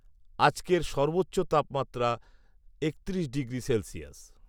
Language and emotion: Bengali, neutral